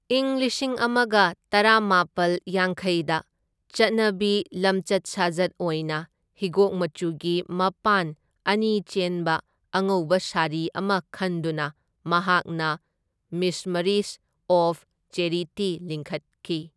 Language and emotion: Manipuri, neutral